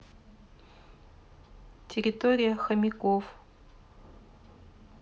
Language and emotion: Russian, neutral